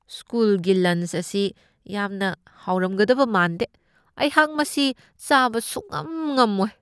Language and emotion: Manipuri, disgusted